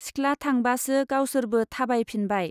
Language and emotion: Bodo, neutral